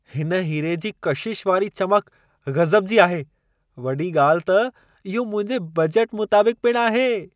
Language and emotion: Sindhi, surprised